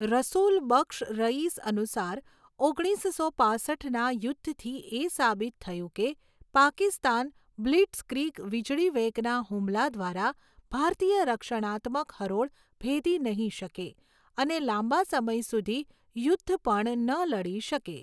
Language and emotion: Gujarati, neutral